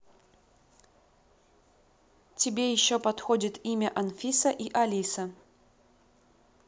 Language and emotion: Russian, neutral